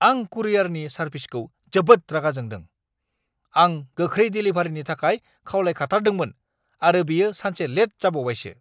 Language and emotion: Bodo, angry